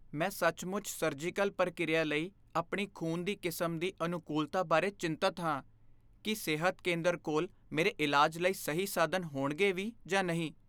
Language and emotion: Punjabi, fearful